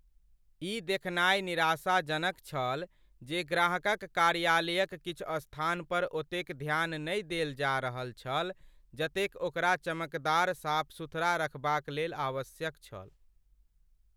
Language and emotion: Maithili, sad